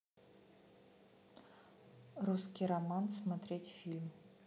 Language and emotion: Russian, neutral